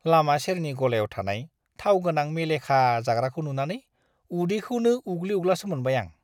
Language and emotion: Bodo, disgusted